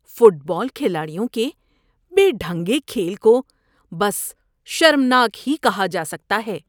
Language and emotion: Urdu, disgusted